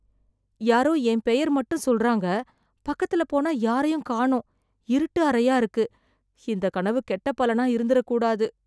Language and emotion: Tamil, fearful